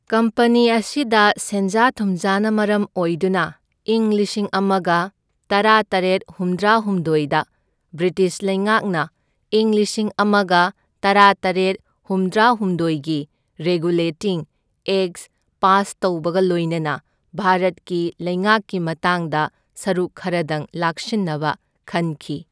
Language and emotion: Manipuri, neutral